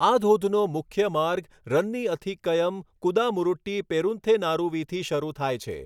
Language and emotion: Gujarati, neutral